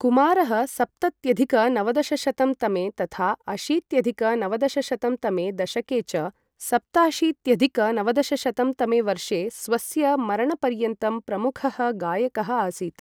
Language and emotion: Sanskrit, neutral